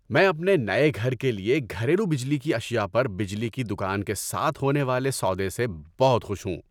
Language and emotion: Urdu, happy